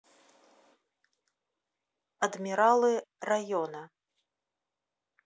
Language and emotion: Russian, neutral